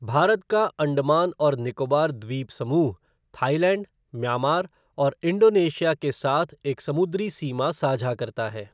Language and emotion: Hindi, neutral